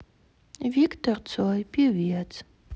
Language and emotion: Russian, sad